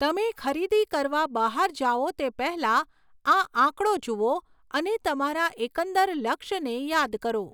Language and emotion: Gujarati, neutral